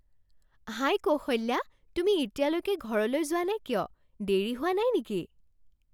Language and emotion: Assamese, surprised